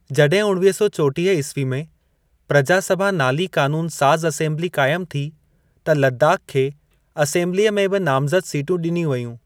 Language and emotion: Sindhi, neutral